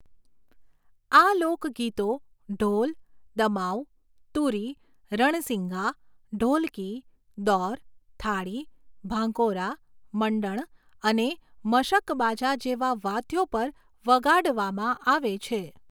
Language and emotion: Gujarati, neutral